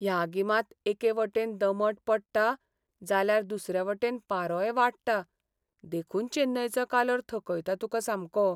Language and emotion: Goan Konkani, sad